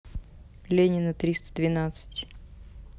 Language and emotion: Russian, neutral